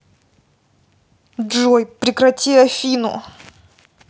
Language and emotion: Russian, angry